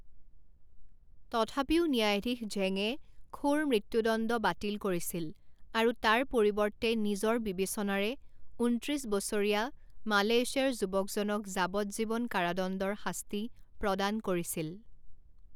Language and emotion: Assamese, neutral